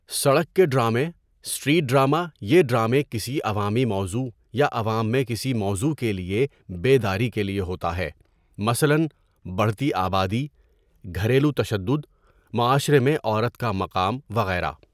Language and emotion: Urdu, neutral